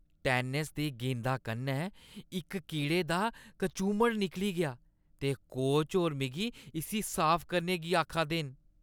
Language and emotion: Dogri, disgusted